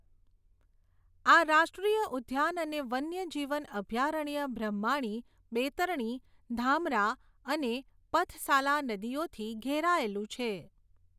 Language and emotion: Gujarati, neutral